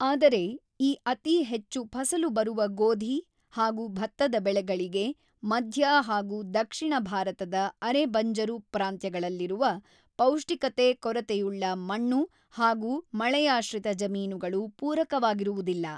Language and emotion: Kannada, neutral